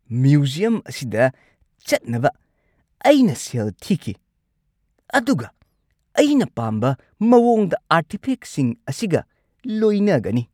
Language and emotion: Manipuri, angry